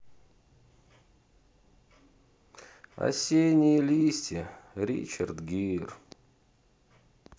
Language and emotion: Russian, sad